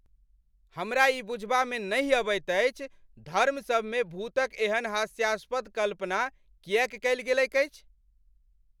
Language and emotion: Maithili, angry